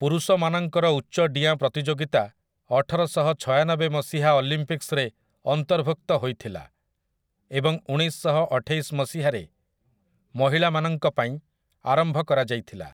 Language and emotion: Odia, neutral